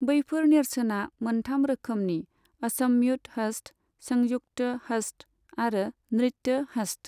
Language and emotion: Bodo, neutral